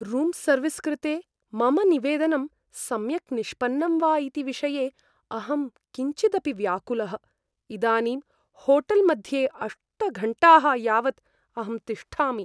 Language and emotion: Sanskrit, fearful